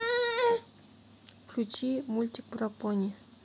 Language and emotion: Russian, neutral